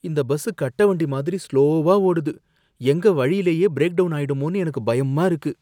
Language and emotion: Tamil, fearful